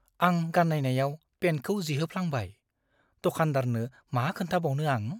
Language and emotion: Bodo, fearful